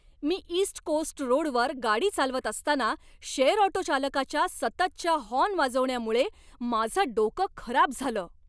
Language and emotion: Marathi, angry